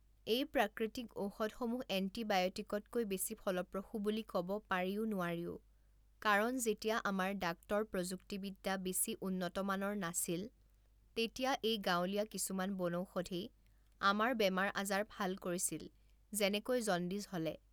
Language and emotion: Assamese, neutral